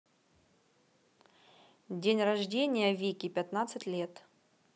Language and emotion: Russian, neutral